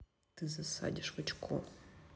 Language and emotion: Russian, neutral